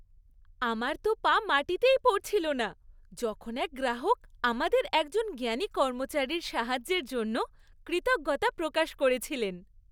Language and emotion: Bengali, happy